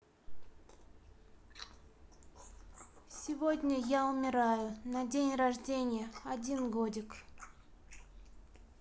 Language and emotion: Russian, neutral